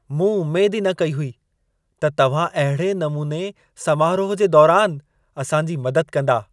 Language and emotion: Sindhi, surprised